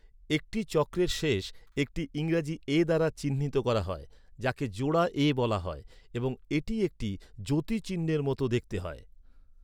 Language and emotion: Bengali, neutral